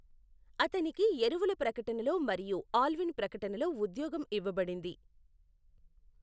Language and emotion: Telugu, neutral